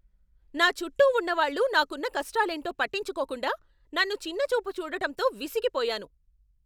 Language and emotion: Telugu, angry